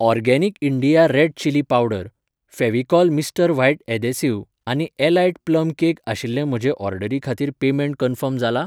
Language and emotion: Goan Konkani, neutral